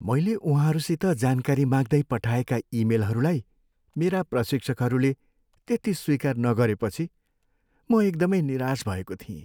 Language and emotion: Nepali, sad